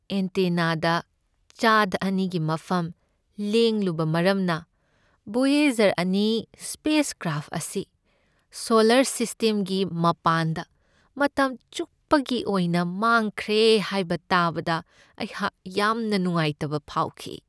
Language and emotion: Manipuri, sad